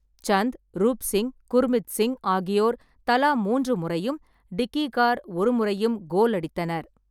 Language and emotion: Tamil, neutral